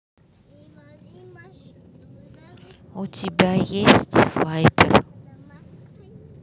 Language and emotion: Russian, neutral